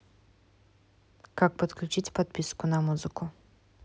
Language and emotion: Russian, neutral